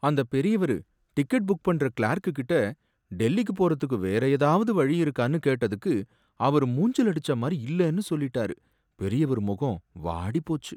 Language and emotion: Tamil, sad